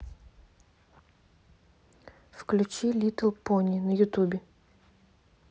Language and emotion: Russian, neutral